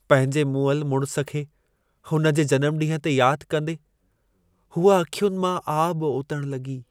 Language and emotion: Sindhi, sad